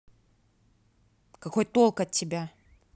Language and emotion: Russian, angry